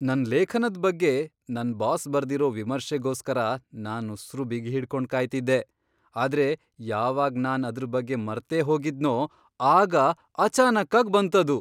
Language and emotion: Kannada, surprised